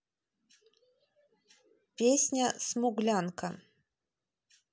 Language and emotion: Russian, neutral